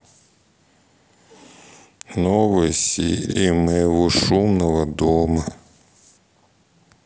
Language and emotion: Russian, sad